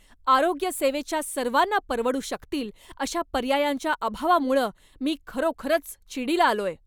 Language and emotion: Marathi, angry